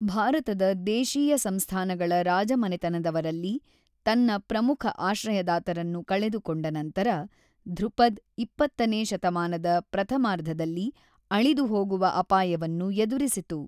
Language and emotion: Kannada, neutral